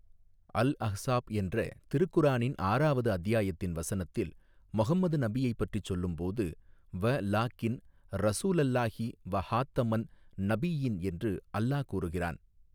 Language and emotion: Tamil, neutral